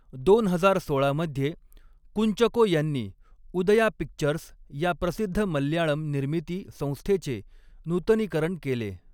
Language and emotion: Marathi, neutral